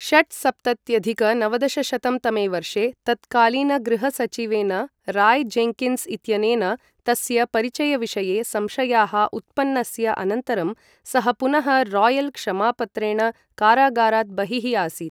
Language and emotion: Sanskrit, neutral